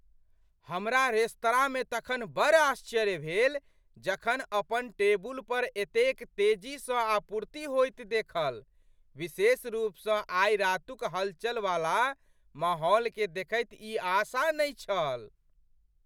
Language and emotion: Maithili, surprised